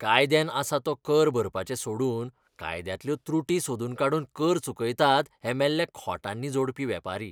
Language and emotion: Goan Konkani, disgusted